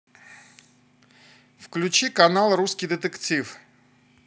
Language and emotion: Russian, positive